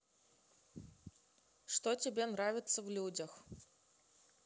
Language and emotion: Russian, neutral